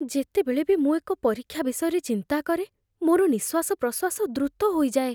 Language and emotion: Odia, fearful